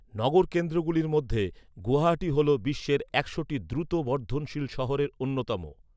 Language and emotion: Bengali, neutral